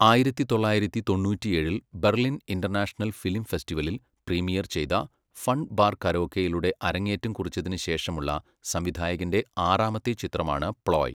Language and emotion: Malayalam, neutral